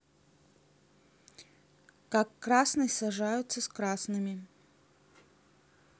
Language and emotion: Russian, neutral